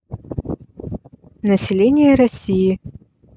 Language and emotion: Russian, neutral